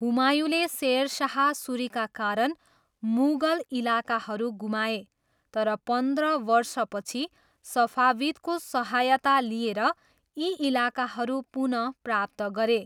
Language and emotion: Nepali, neutral